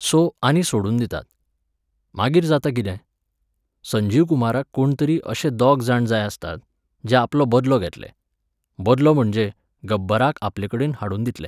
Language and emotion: Goan Konkani, neutral